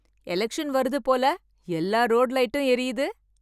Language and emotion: Tamil, happy